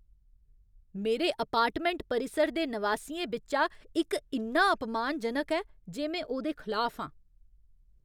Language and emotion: Dogri, angry